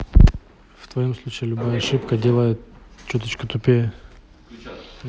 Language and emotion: Russian, neutral